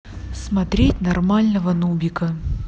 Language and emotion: Russian, neutral